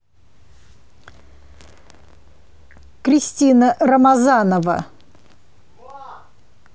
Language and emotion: Russian, neutral